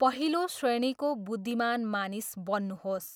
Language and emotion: Nepali, neutral